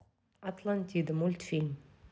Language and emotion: Russian, neutral